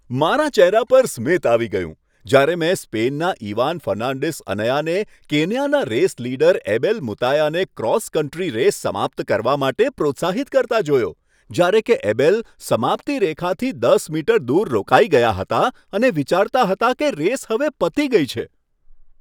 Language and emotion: Gujarati, happy